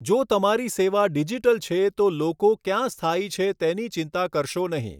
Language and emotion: Gujarati, neutral